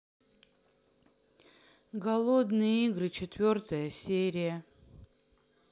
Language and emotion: Russian, sad